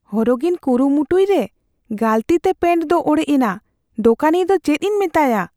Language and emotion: Santali, fearful